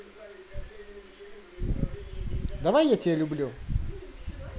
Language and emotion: Russian, positive